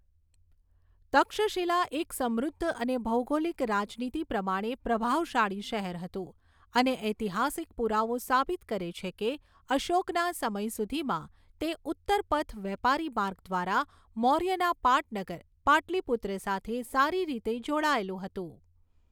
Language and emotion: Gujarati, neutral